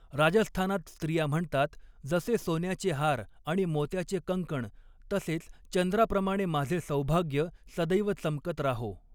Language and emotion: Marathi, neutral